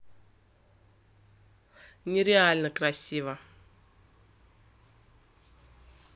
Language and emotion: Russian, positive